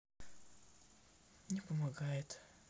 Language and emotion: Russian, sad